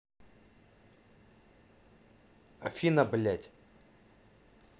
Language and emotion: Russian, angry